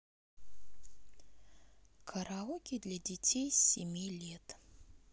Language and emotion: Russian, neutral